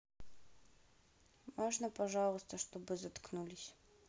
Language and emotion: Russian, sad